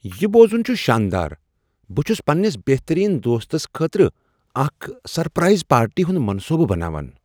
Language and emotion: Kashmiri, surprised